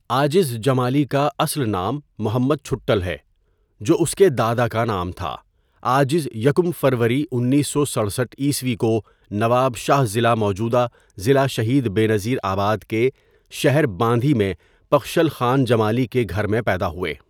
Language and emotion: Urdu, neutral